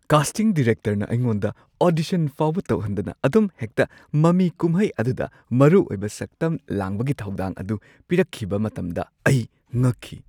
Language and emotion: Manipuri, surprised